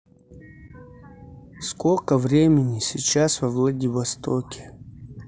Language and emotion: Russian, neutral